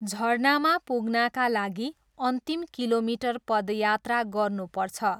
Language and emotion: Nepali, neutral